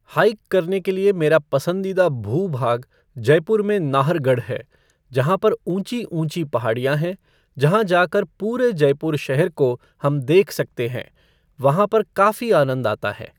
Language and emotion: Hindi, neutral